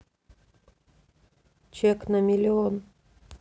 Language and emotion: Russian, neutral